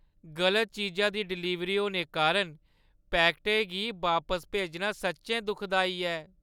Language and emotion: Dogri, sad